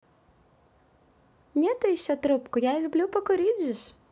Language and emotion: Russian, positive